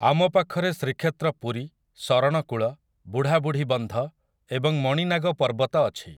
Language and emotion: Odia, neutral